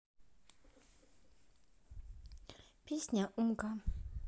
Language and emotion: Russian, neutral